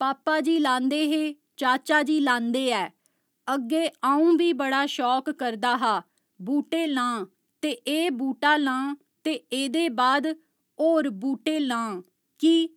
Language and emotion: Dogri, neutral